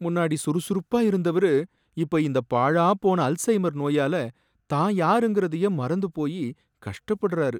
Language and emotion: Tamil, sad